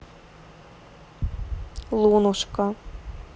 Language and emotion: Russian, neutral